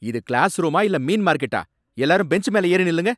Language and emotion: Tamil, angry